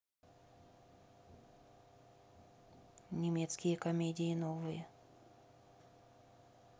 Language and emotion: Russian, neutral